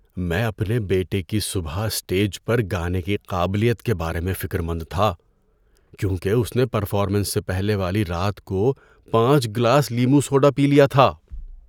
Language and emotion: Urdu, fearful